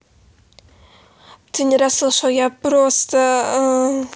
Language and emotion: Russian, neutral